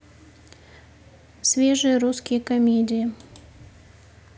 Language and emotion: Russian, neutral